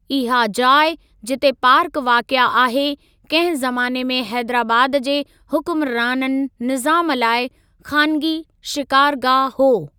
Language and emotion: Sindhi, neutral